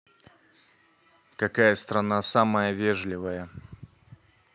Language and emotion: Russian, neutral